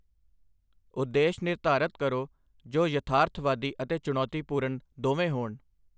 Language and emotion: Punjabi, neutral